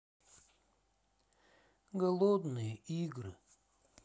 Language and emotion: Russian, sad